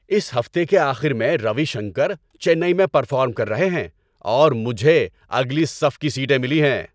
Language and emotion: Urdu, happy